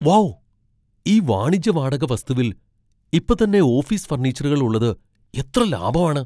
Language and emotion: Malayalam, surprised